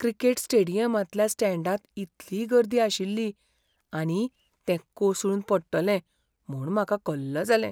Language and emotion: Goan Konkani, fearful